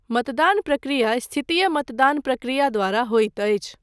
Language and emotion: Maithili, neutral